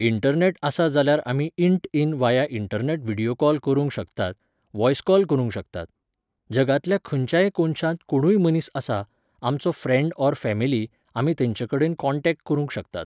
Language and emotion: Goan Konkani, neutral